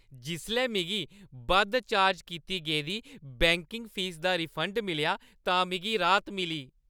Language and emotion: Dogri, happy